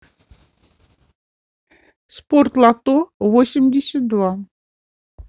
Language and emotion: Russian, neutral